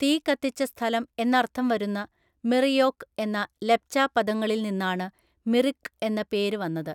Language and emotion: Malayalam, neutral